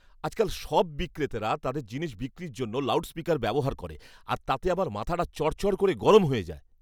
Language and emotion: Bengali, angry